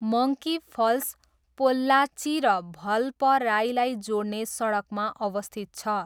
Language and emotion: Nepali, neutral